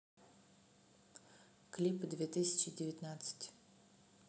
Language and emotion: Russian, neutral